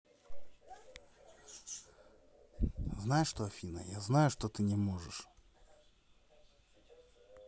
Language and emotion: Russian, neutral